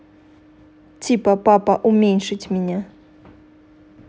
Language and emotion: Russian, neutral